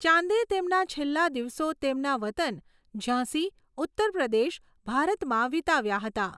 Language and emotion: Gujarati, neutral